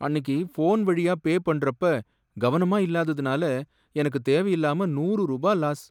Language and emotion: Tamil, sad